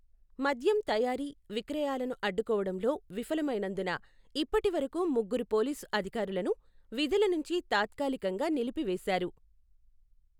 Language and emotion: Telugu, neutral